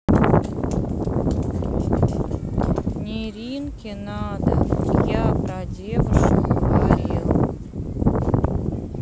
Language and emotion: Russian, neutral